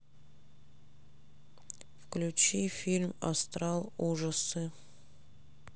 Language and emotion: Russian, neutral